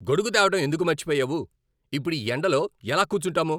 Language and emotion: Telugu, angry